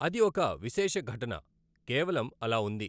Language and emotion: Telugu, neutral